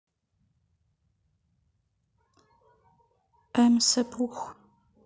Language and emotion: Russian, neutral